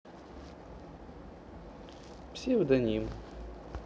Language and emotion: Russian, neutral